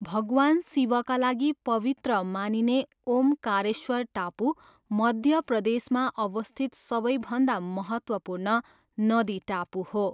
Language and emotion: Nepali, neutral